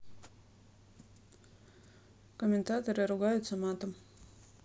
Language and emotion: Russian, neutral